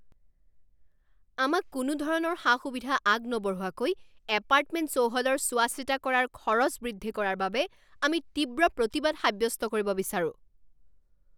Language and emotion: Assamese, angry